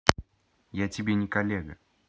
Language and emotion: Russian, angry